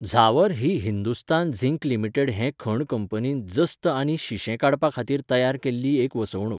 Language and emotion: Goan Konkani, neutral